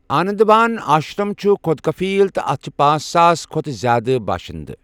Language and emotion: Kashmiri, neutral